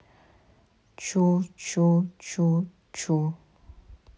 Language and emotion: Russian, neutral